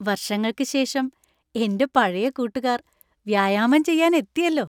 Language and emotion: Malayalam, happy